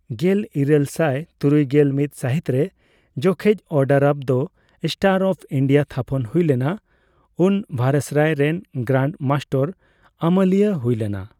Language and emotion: Santali, neutral